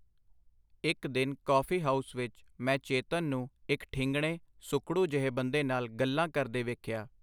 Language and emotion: Punjabi, neutral